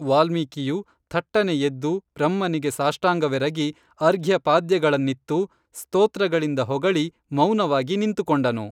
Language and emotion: Kannada, neutral